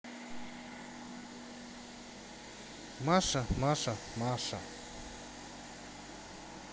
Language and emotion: Russian, neutral